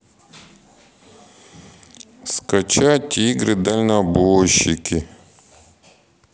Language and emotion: Russian, sad